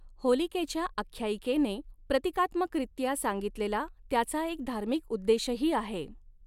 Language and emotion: Marathi, neutral